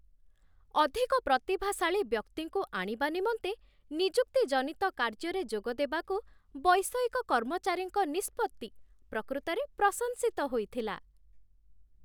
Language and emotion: Odia, happy